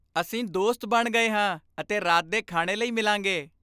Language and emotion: Punjabi, happy